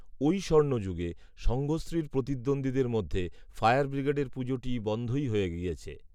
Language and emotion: Bengali, neutral